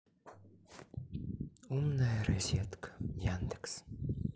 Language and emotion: Russian, sad